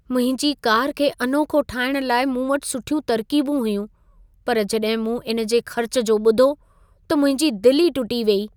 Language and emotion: Sindhi, sad